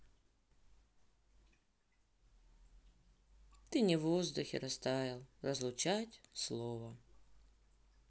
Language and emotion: Russian, sad